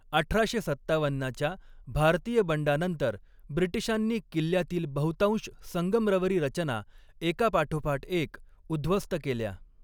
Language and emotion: Marathi, neutral